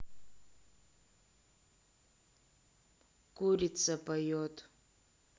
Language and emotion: Russian, neutral